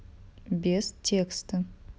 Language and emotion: Russian, neutral